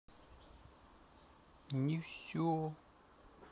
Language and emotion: Russian, sad